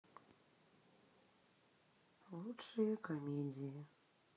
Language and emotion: Russian, sad